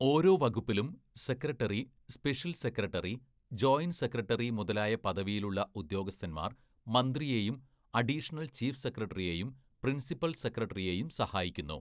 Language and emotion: Malayalam, neutral